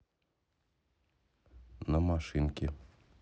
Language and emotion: Russian, neutral